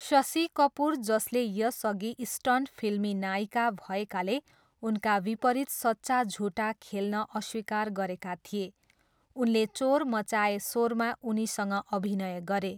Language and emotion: Nepali, neutral